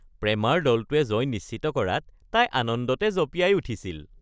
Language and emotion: Assamese, happy